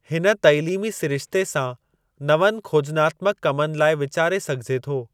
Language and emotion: Sindhi, neutral